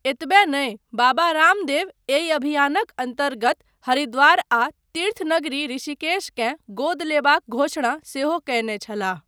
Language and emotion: Maithili, neutral